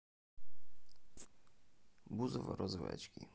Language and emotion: Russian, neutral